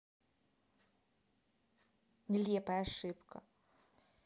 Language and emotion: Russian, angry